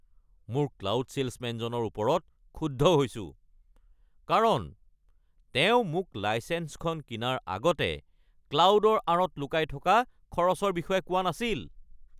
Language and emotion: Assamese, angry